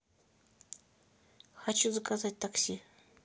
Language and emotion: Russian, neutral